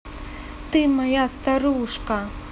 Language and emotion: Russian, positive